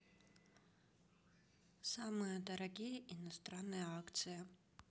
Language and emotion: Russian, neutral